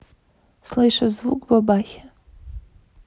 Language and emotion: Russian, neutral